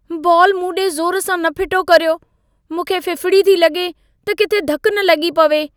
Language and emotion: Sindhi, fearful